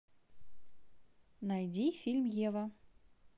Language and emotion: Russian, positive